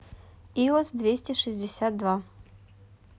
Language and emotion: Russian, neutral